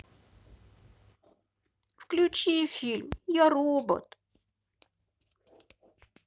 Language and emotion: Russian, sad